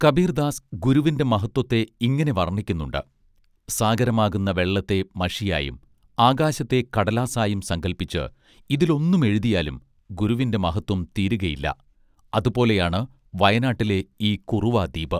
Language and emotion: Malayalam, neutral